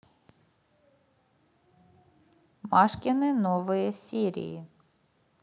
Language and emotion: Russian, neutral